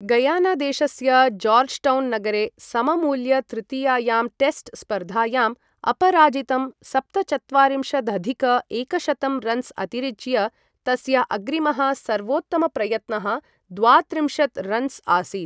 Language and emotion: Sanskrit, neutral